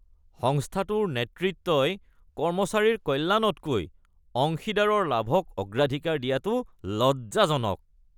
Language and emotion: Assamese, disgusted